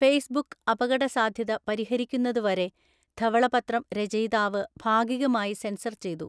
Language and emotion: Malayalam, neutral